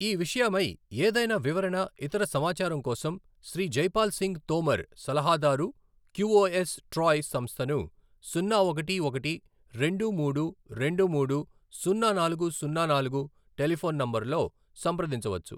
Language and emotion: Telugu, neutral